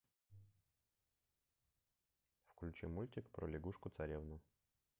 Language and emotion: Russian, neutral